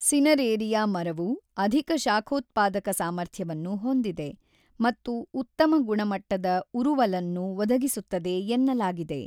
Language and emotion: Kannada, neutral